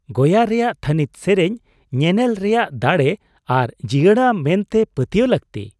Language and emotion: Santali, surprised